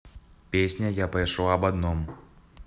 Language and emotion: Russian, neutral